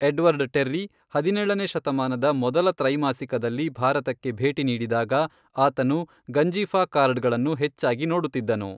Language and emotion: Kannada, neutral